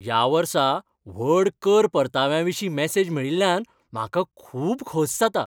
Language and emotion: Goan Konkani, happy